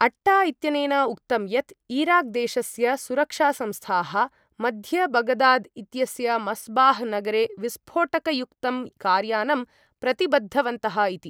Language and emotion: Sanskrit, neutral